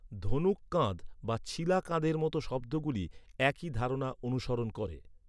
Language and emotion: Bengali, neutral